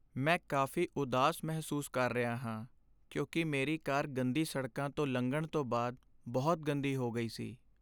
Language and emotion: Punjabi, sad